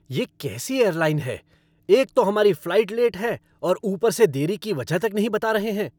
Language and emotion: Hindi, angry